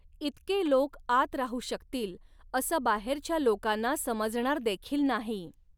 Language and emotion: Marathi, neutral